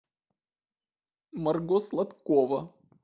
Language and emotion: Russian, sad